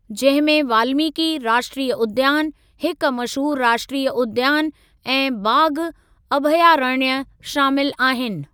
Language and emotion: Sindhi, neutral